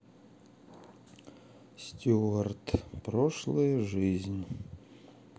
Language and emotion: Russian, sad